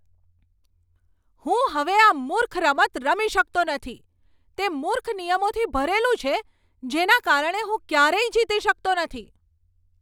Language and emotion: Gujarati, angry